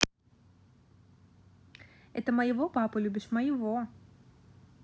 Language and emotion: Russian, positive